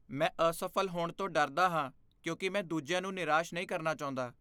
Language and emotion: Punjabi, fearful